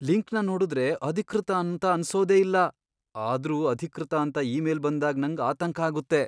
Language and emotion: Kannada, fearful